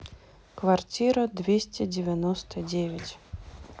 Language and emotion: Russian, neutral